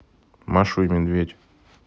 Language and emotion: Russian, neutral